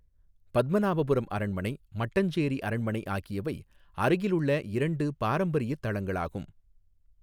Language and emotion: Tamil, neutral